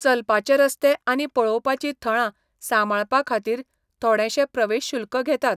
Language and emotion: Goan Konkani, neutral